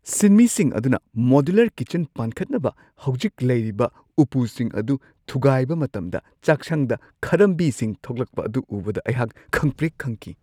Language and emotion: Manipuri, surprised